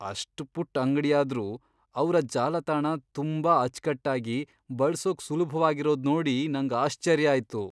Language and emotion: Kannada, surprised